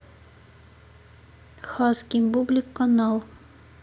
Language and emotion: Russian, neutral